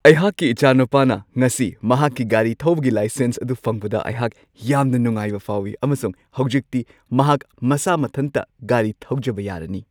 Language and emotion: Manipuri, happy